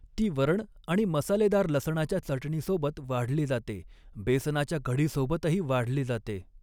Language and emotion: Marathi, neutral